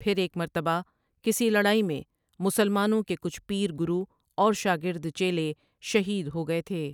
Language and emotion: Urdu, neutral